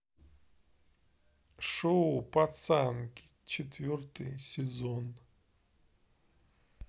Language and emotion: Russian, neutral